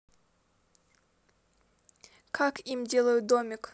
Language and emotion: Russian, neutral